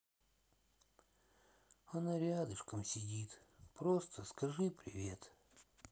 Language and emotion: Russian, sad